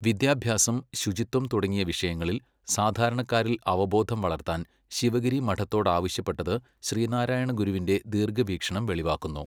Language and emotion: Malayalam, neutral